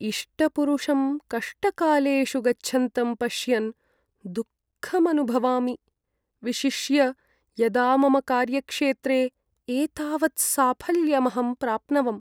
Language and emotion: Sanskrit, sad